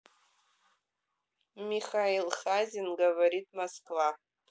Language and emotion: Russian, neutral